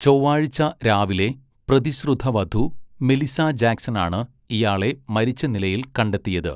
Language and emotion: Malayalam, neutral